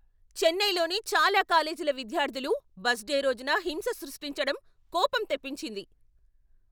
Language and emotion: Telugu, angry